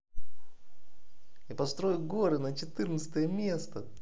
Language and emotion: Russian, positive